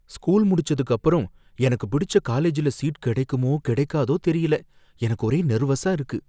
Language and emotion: Tamil, fearful